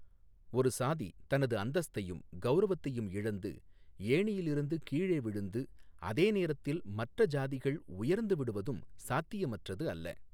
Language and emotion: Tamil, neutral